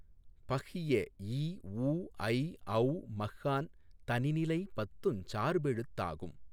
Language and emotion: Tamil, neutral